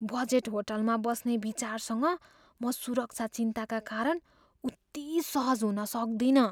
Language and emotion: Nepali, fearful